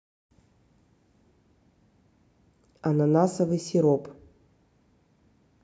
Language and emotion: Russian, neutral